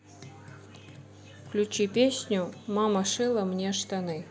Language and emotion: Russian, neutral